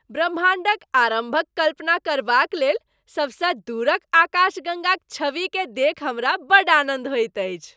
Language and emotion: Maithili, happy